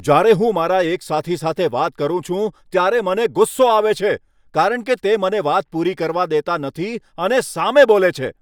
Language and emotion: Gujarati, angry